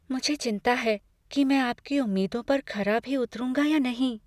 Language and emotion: Hindi, fearful